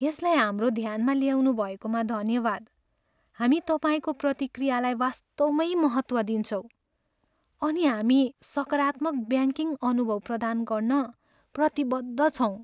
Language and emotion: Nepali, sad